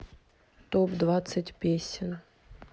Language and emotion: Russian, neutral